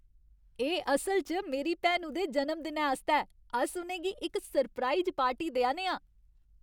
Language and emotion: Dogri, happy